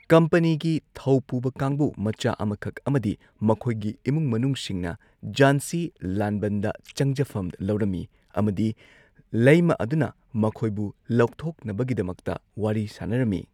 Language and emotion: Manipuri, neutral